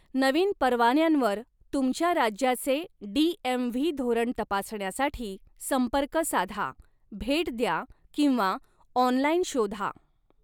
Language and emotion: Marathi, neutral